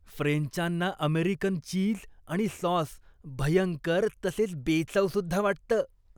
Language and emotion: Marathi, disgusted